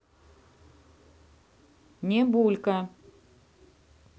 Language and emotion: Russian, neutral